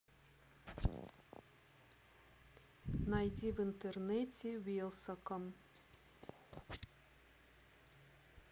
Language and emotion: Russian, neutral